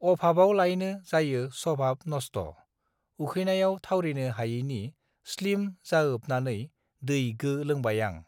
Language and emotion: Bodo, neutral